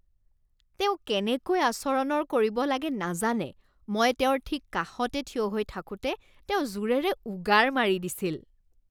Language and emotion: Assamese, disgusted